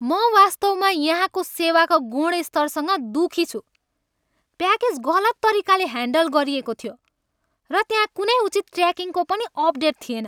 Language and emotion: Nepali, angry